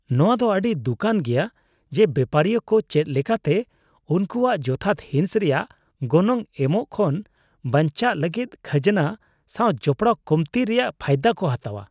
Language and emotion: Santali, disgusted